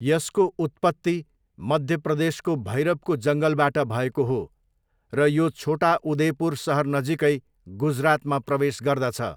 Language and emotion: Nepali, neutral